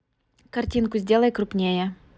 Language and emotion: Russian, neutral